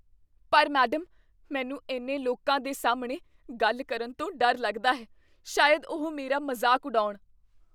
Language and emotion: Punjabi, fearful